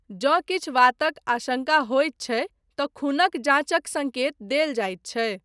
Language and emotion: Maithili, neutral